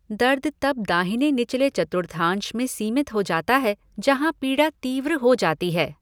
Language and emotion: Hindi, neutral